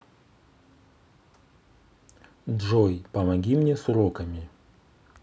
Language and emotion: Russian, neutral